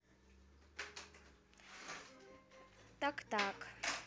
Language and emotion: Russian, neutral